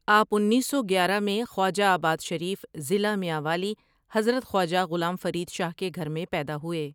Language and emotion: Urdu, neutral